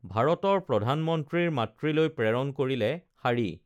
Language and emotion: Assamese, neutral